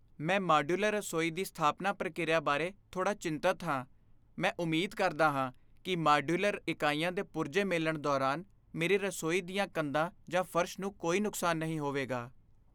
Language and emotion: Punjabi, fearful